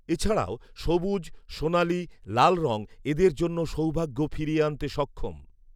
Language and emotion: Bengali, neutral